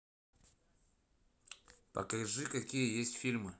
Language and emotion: Russian, neutral